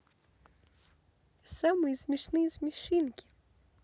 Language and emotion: Russian, positive